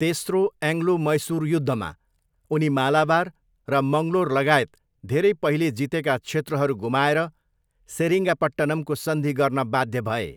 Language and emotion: Nepali, neutral